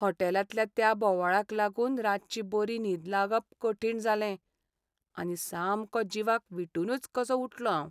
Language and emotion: Goan Konkani, sad